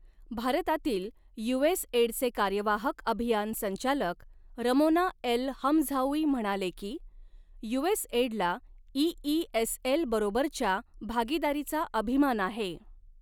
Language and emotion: Marathi, neutral